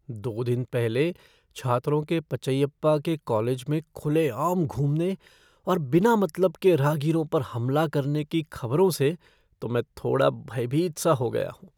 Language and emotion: Hindi, fearful